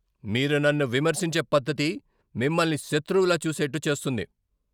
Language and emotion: Telugu, angry